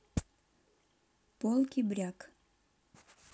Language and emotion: Russian, neutral